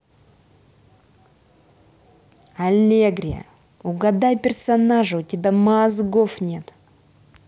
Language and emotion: Russian, angry